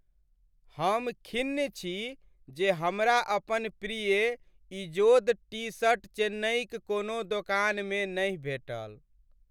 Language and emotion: Maithili, sad